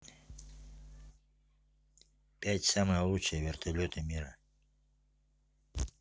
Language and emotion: Russian, neutral